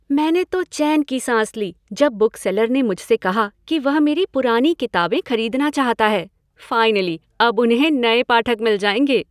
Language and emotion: Hindi, happy